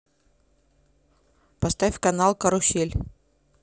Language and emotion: Russian, neutral